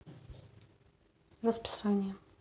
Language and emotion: Russian, neutral